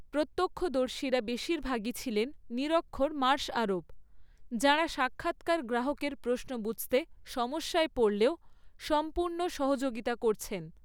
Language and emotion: Bengali, neutral